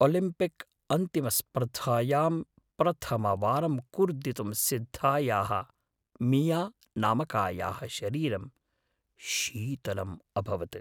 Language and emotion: Sanskrit, fearful